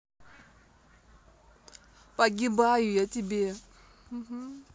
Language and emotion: Russian, neutral